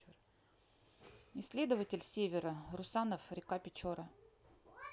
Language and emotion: Russian, neutral